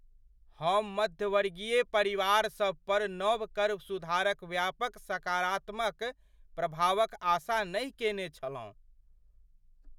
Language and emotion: Maithili, surprised